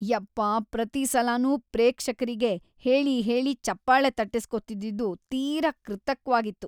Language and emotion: Kannada, disgusted